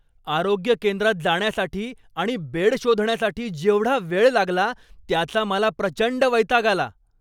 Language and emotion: Marathi, angry